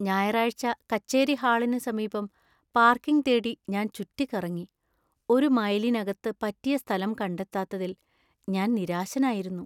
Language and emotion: Malayalam, sad